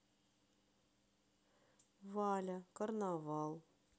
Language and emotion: Russian, sad